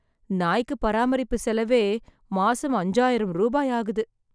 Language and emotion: Tamil, sad